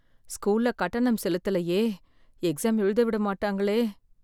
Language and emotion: Tamil, fearful